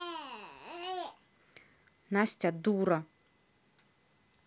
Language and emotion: Russian, angry